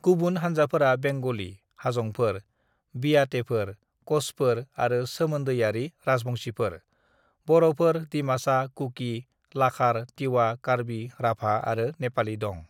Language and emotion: Bodo, neutral